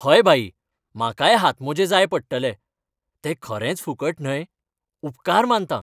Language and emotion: Goan Konkani, happy